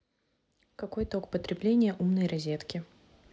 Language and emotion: Russian, neutral